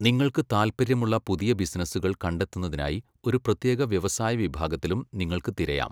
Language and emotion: Malayalam, neutral